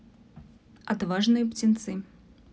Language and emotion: Russian, neutral